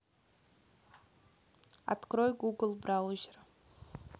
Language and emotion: Russian, neutral